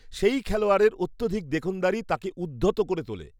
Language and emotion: Bengali, disgusted